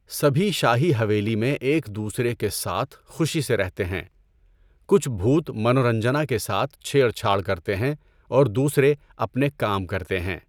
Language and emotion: Urdu, neutral